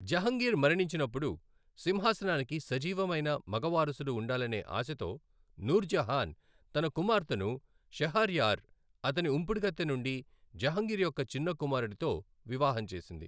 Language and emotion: Telugu, neutral